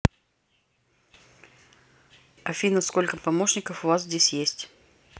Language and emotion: Russian, neutral